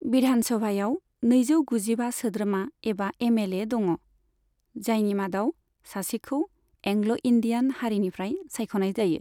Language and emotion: Bodo, neutral